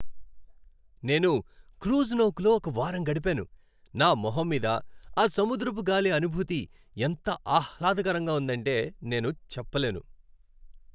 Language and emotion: Telugu, happy